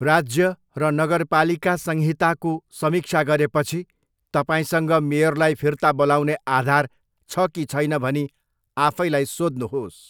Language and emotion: Nepali, neutral